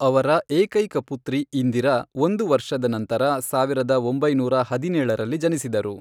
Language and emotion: Kannada, neutral